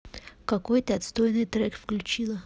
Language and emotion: Russian, neutral